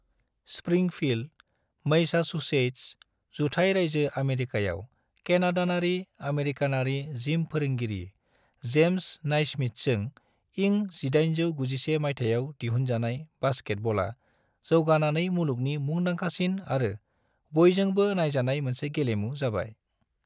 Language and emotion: Bodo, neutral